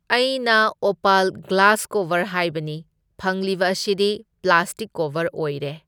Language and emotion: Manipuri, neutral